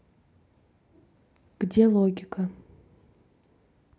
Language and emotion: Russian, neutral